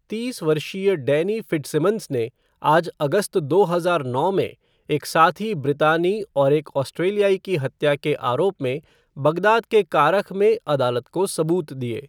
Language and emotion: Hindi, neutral